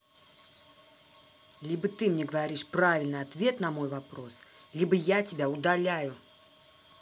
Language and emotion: Russian, angry